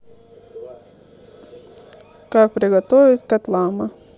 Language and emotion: Russian, neutral